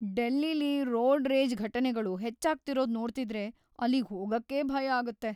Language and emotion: Kannada, fearful